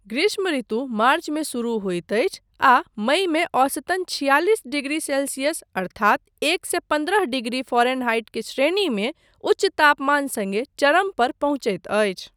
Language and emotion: Maithili, neutral